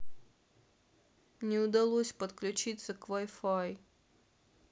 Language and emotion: Russian, sad